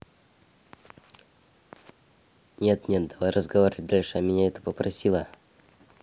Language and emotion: Russian, neutral